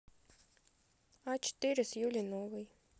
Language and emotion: Russian, neutral